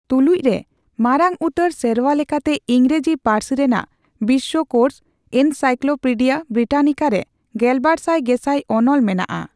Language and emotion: Santali, neutral